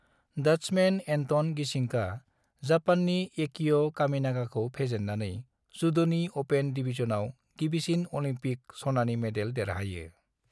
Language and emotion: Bodo, neutral